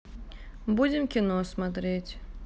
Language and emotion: Russian, neutral